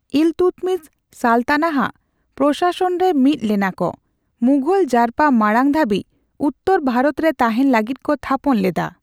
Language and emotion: Santali, neutral